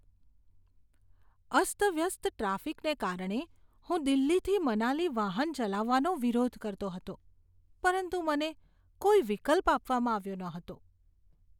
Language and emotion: Gujarati, disgusted